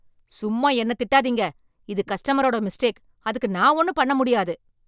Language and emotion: Tamil, angry